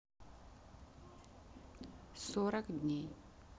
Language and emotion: Russian, neutral